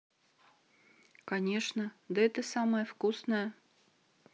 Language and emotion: Russian, neutral